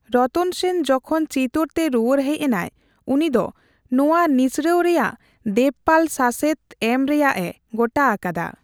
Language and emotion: Santali, neutral